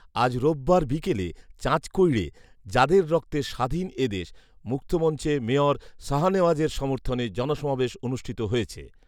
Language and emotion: Bengali, neutral